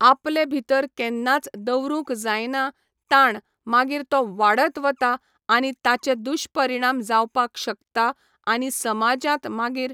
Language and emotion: Goan Konkani, neutral